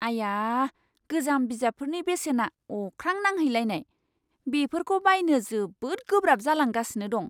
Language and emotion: Bodo, surprised